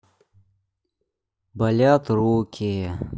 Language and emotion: Russian, sad